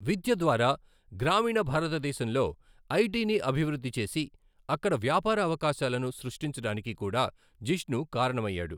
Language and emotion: Telugu, neutral